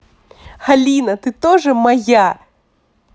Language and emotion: Russian, positive